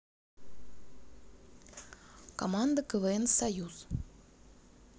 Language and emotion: Russian, neutral